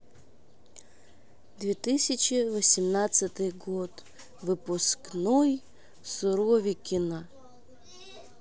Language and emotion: Russian, neutral